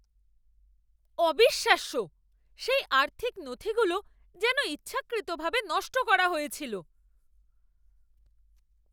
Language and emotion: Bengali, angry